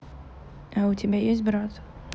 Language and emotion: Russian, neutral